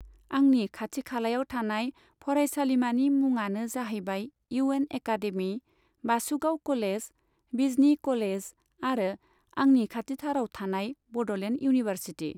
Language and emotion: Bodo, neutral